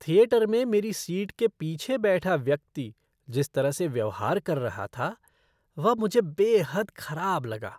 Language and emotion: Hindi, disgusted